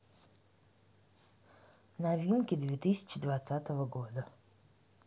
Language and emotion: Russian, neutral